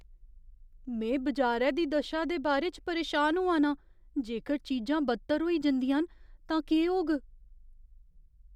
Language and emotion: Dogri, fearful